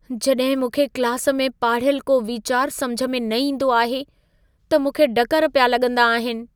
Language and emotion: Sindhi, fearful